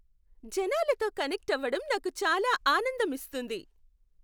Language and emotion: Telugu, happy